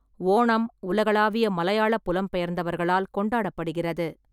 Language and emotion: Tamil, neutral